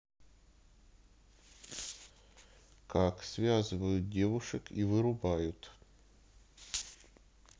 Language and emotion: Russian, neutral